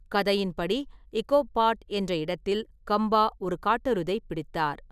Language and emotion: Tamil, neutral